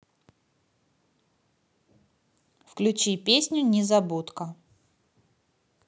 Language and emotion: Russian, neutral